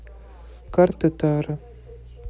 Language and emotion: Russian, neutral